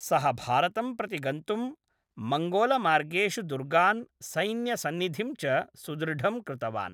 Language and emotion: Sanskrit, neutral